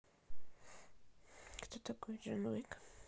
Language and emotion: Russian, sad